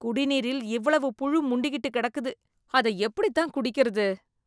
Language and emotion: Tamil, disgusted